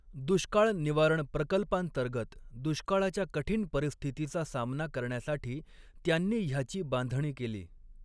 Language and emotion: Marathi, neutral